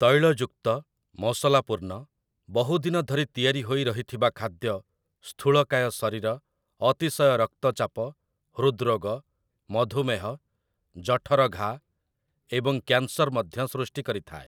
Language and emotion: Odia, neutral